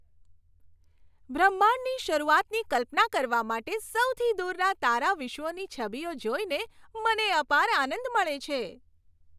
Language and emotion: Gujarati, happy